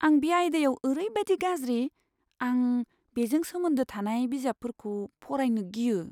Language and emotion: Bodo, fearful